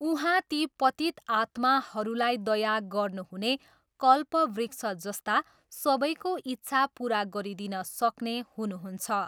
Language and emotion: Nepali, neutral